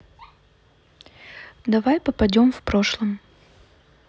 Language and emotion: Russian, neutral